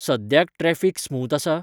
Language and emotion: Goan Konkani, neutral